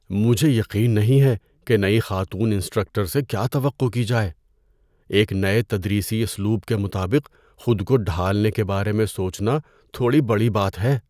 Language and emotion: Urdu, fearful